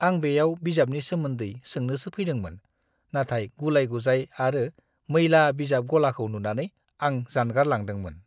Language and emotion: Bodo, disgusted